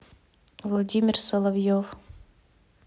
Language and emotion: Russian, neutral